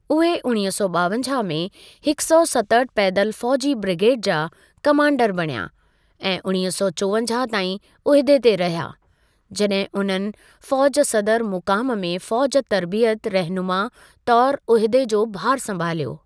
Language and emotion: Sindhi, neutral